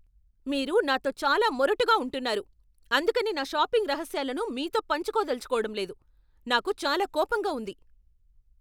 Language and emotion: Telugu, angry